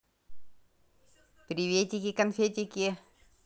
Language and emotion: Russian, positive